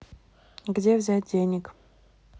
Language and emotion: Russian, neutral